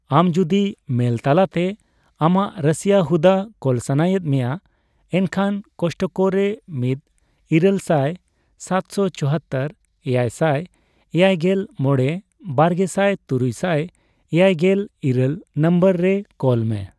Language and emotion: Santali, neutral